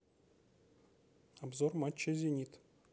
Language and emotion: Russian, neutral